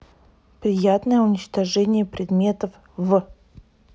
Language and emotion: Russian, neutral